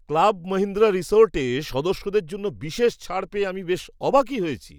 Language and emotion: Bengali, surprised